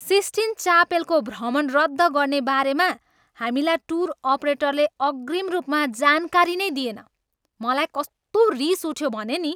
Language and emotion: Nepali, angry